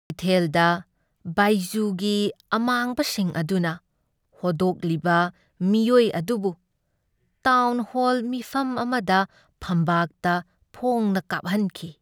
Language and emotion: Manipuri, sad